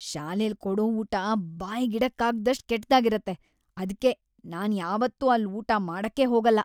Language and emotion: Kannada, disgusted